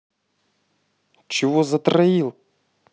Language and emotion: Russian, angry